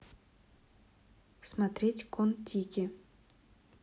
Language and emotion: Russian, neutral